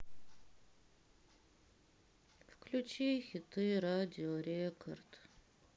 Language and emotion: Russian, sad